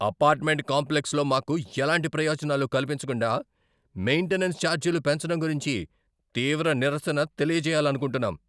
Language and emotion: Telugu, angry